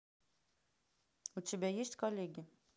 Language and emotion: Russian, neutral